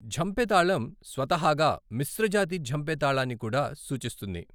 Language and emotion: Telugu, neutral